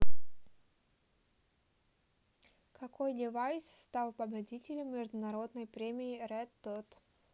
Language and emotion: Russian, neutral